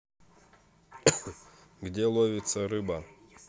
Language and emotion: Russian, neutral